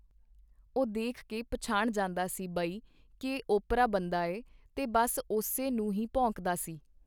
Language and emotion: Punjabi, neutral